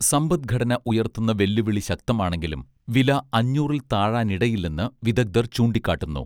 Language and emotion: Malayalam, neutral